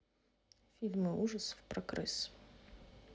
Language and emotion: Russian, neutral